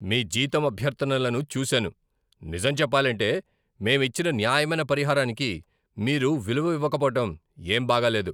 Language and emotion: Telugu, angry